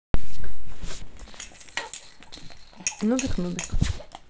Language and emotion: Russian, neutral